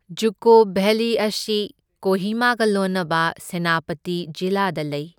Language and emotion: Manipuri, neutral